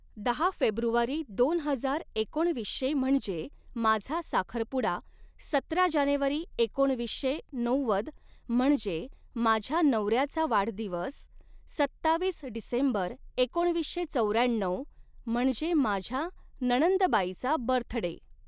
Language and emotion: Marathi, neutral